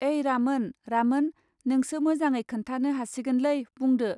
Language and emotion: Bodo, neutral